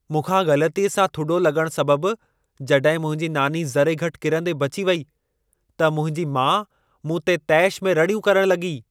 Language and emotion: Sindhi, angry